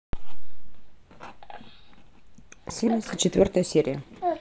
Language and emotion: Russian, neutral